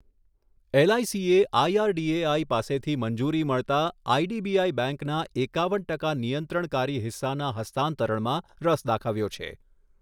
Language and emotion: Gujarati, neutral